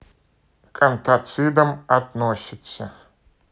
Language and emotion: Russian, neutral